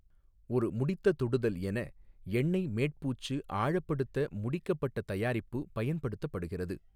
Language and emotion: Tamil, neutral